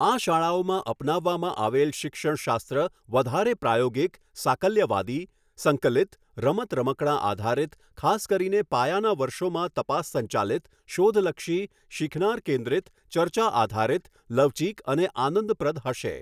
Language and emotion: Gujarati, neutral